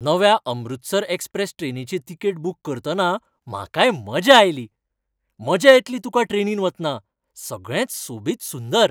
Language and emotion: Goan Konkani, happy